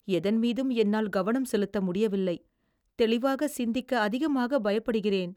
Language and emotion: Tamil, fearful